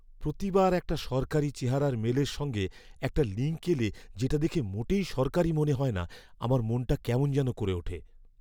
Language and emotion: Bengali, fearful